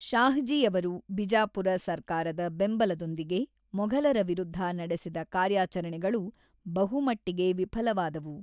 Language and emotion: Kannada, neutral